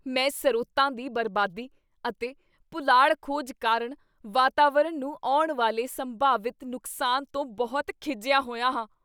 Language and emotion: Punjabi, disgusted